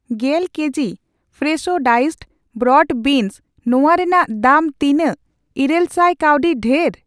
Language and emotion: Santali, neutral